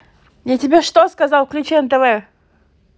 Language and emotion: Russian, angry